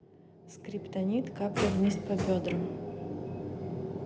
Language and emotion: Russian, neutral